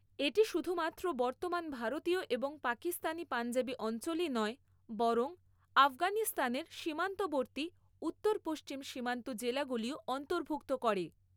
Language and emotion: Bengali, neutral